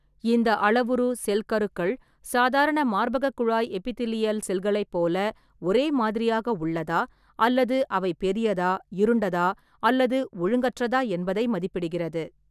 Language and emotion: Tamil, neutral